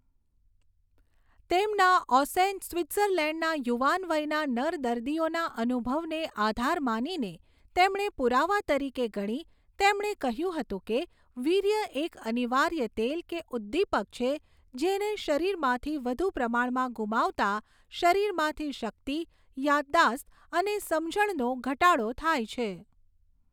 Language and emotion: Gujarati, neutral